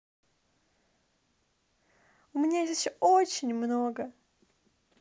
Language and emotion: Russian, positive